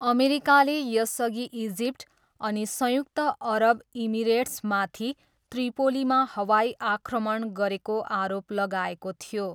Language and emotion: Nepali, neutral